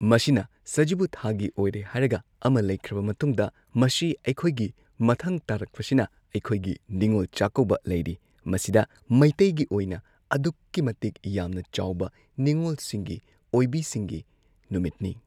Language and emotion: Manipuri, neutral